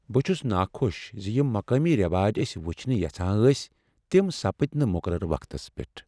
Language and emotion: Kashmiri, sad